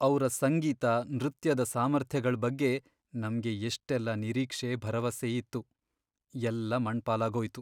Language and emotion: Kannada, sad